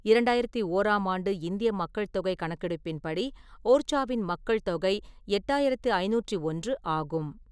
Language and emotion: Tamil, neutral